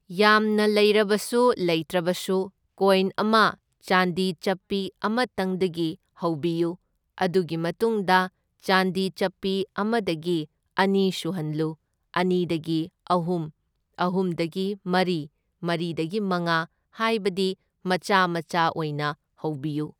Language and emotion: Manipuri, neutral